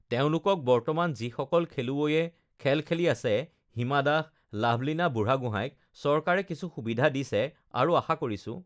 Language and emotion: Assamese, neutral